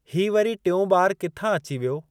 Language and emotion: Sindhi, neutral